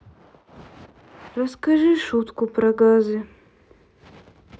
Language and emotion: Russian, sad